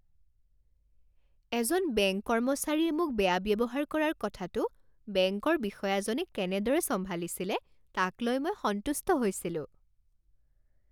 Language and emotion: Assamese, happy